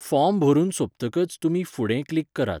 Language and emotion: Goan Konkani, neutral